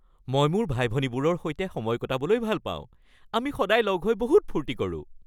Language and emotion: Assamese, happy